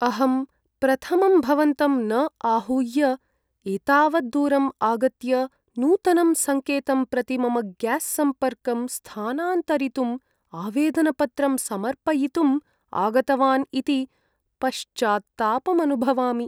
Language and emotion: Sanskrit, sad